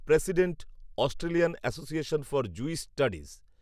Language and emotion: Bengali, neutral